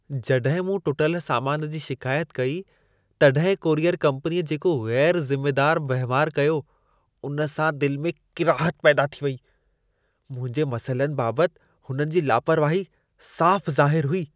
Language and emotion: Sindhi, disgusted